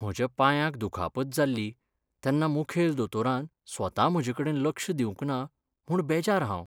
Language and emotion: Goan Konkani, sad